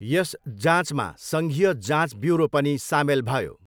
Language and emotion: Nepali, neutral